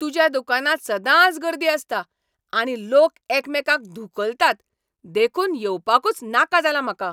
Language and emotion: Goan Konkani, angry